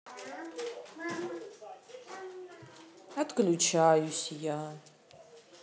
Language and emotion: Russian, sad